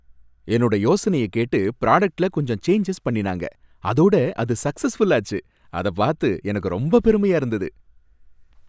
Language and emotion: Tamil, happy